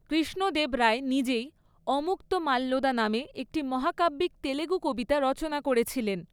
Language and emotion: Bengali, neutral